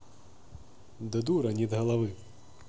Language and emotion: Russian, neutral